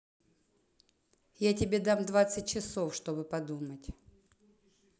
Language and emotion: Russian, neutral